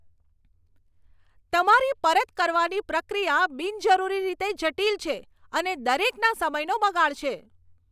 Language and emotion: Gujarati, angry